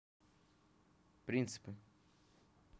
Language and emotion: Russian, neutral